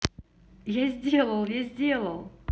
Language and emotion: Russian, positive